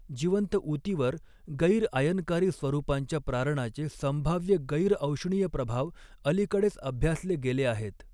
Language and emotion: Marathi, neutral